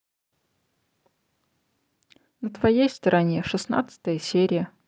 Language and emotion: Russian, neutral